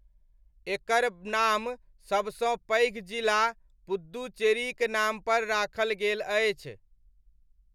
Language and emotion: Maithili, neutral